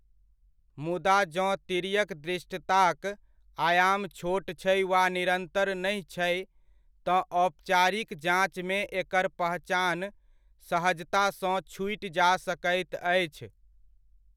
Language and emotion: Maithili, neutral